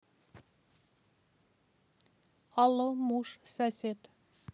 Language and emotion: Russian, neutral